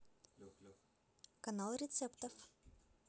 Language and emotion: Russian, positive